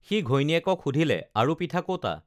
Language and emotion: Assamese, neutral